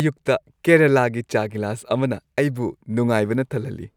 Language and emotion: Manipuri, happy